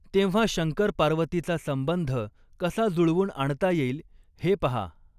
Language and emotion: Marathi, neutral